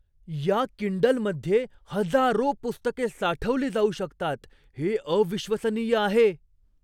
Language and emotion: Marathi, surprised